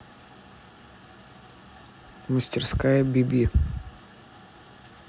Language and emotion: Russian, neutral